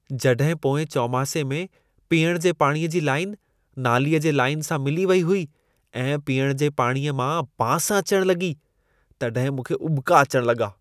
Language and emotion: Sindhi, disgusted